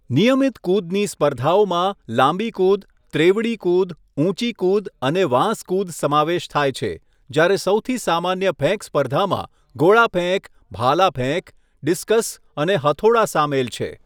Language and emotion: Gujarati, neutral